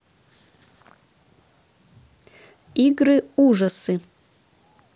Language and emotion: Russian, neutral